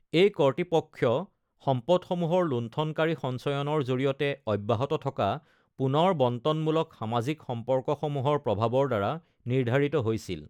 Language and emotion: Assamese, neutral